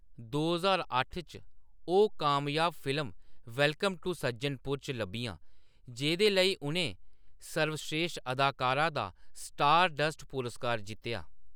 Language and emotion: Dogri, neutral